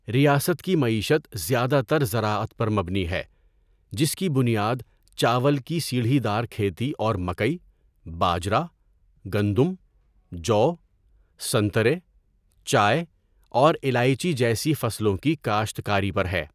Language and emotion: Urdu, neutral